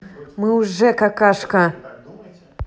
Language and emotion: Russian, angry